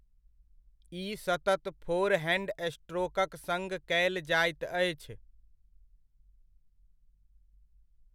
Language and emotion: Maithili, neutral